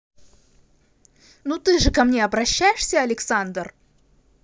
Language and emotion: Russian, angry